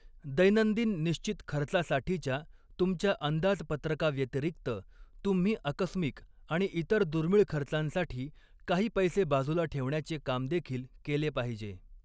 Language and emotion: Marathi, neutral